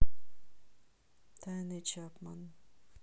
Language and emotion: Russian, neutral